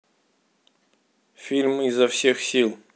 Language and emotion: Russian, neutral